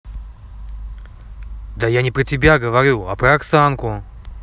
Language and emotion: Russian, angry